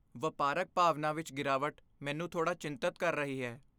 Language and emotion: Punjabi, fearful